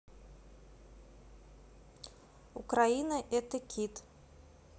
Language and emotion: Russian, neutral